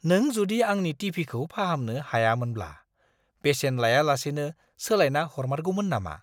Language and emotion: Bodo, surprised